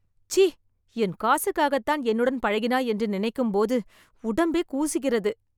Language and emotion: Tamil, disgusted